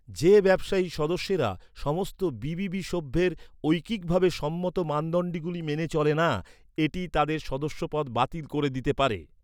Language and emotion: Bengali, neutral